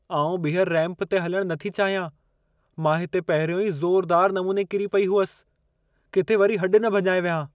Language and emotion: Sindhi, fearful